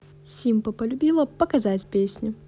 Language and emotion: Russian, positive